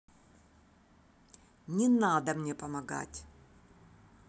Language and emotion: Russian, angry